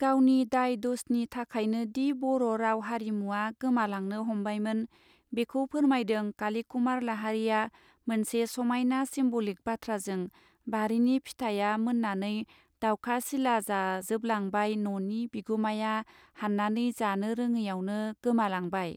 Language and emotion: Bodo, neutral